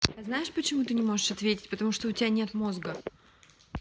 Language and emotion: Russian, angry